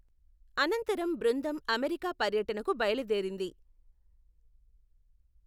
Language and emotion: Telugu, neutral